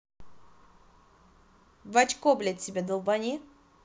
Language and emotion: Russian, angry